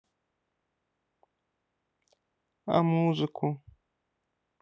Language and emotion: Russian, sad